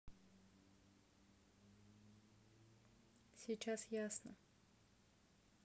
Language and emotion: Russian, neutral